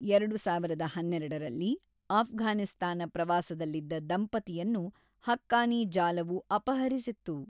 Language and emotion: Kannada, neutral